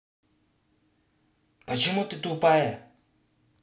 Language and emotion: Russian, angry